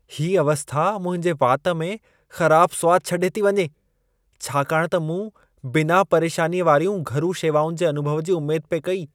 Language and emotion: Sindhi, disgusted